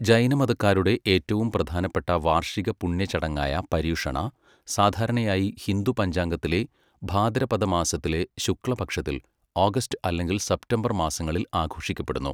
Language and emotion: Malayalam, neutral